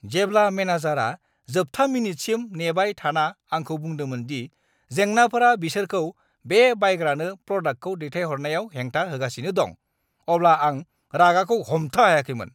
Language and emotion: Bodo, angry